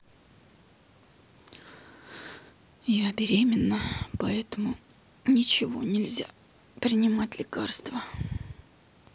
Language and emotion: Russian, sad